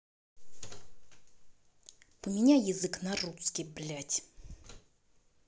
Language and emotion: Russian, angry